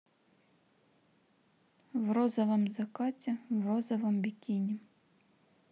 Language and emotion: Russian, neutral